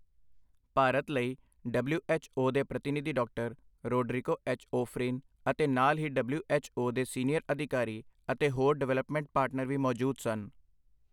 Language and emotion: Punjabi, neutral